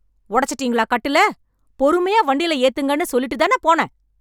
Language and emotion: Tamil, angry